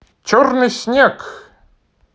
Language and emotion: Russian, positive